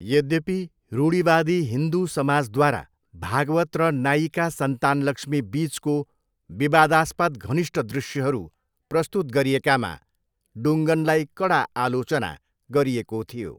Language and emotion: Nepali, neutral